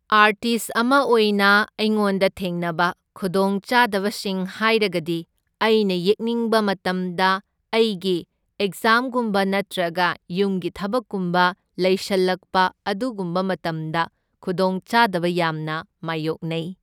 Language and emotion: Manipuri, neutral